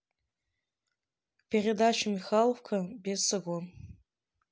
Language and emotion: Russian, neutral